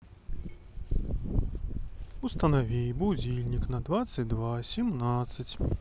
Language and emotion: Russian, neutral